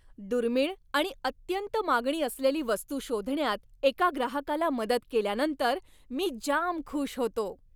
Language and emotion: Marathi, happy